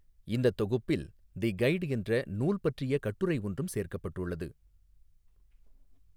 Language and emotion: Tamil, neutral